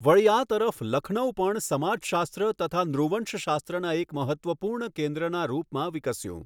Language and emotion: Gujarati, neutral